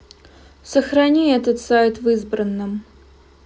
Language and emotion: Russian, neutral